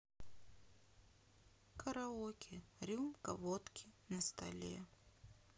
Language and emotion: Russian, sad